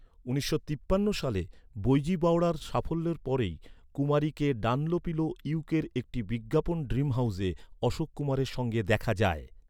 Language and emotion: Bengali, neutral